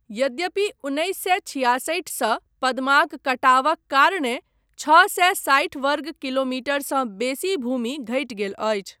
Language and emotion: Maithili, neutral